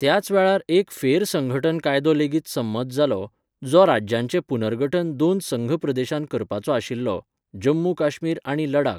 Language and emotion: Goan Konkani, neutral